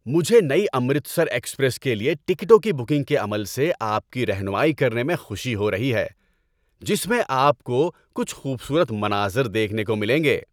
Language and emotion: Urdu, happy